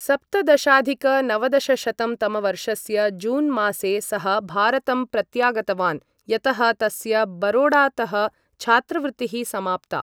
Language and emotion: Sanskrit, neutral